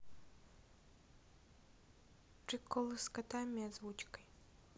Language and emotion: Russian, neutral